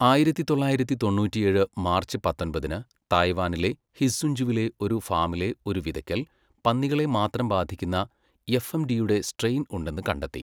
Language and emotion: Malayalam, neutral